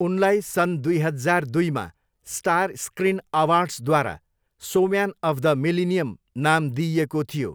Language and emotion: Nepali, neutral